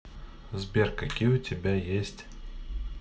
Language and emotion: Russian, neutral